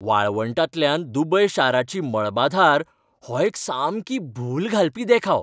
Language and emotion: Goan Konkani, happy